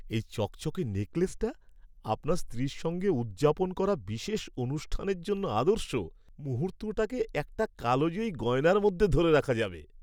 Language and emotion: Bengali, happy